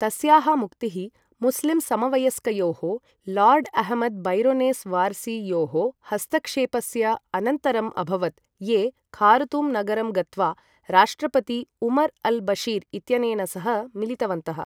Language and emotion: Sanskrit, neutral